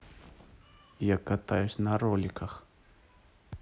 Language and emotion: Russian, neutral